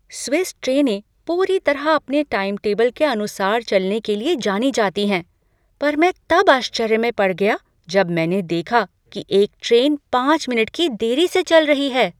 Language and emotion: Hindi, surprised